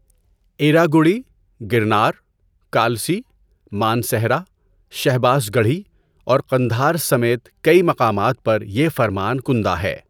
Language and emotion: Urdu, neutral